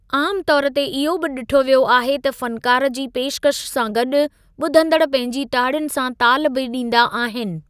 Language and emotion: Sindhi, neutral